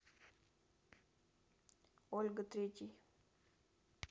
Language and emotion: Russian, neutral